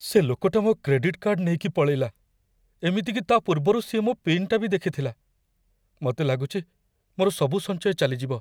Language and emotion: Odia, fearful